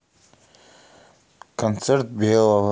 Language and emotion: Russian, neutral